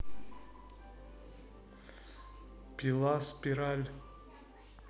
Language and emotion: Russian, neutral